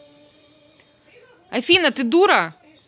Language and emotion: Russian, angry